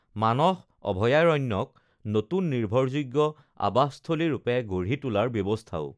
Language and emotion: Assamese, neutral